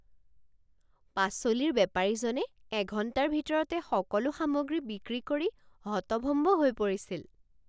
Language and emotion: Assamese, surprised